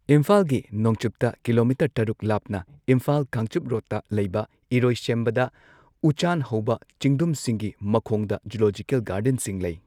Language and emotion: Manipuri, neutral